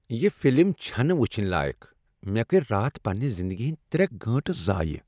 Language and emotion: Kashmiri, disgusted